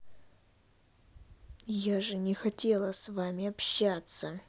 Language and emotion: Russian, angry